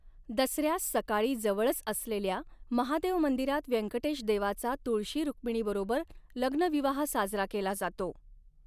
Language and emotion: Marathi, neutral